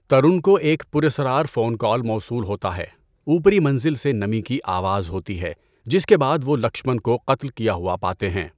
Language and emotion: Urdu, neutral